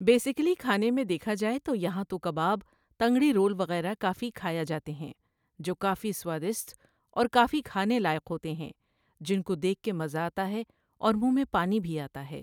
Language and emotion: Urdu, neutral